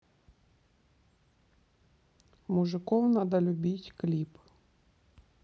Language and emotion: Russian, neutral